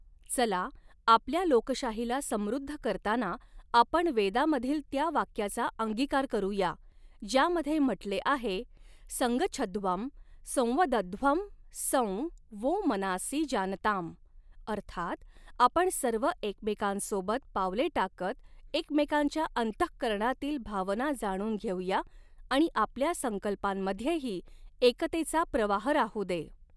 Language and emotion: Marathi, neutral